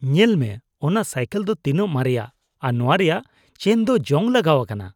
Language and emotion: Santali, disgusted